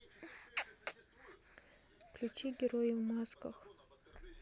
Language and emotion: Russian, neutral